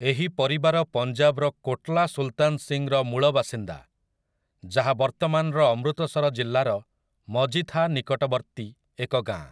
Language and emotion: Odia, neutral